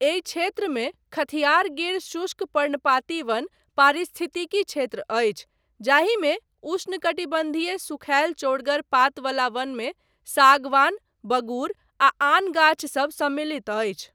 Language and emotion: Maithili, neutral